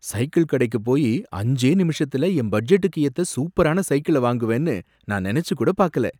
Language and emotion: Tamil, surprised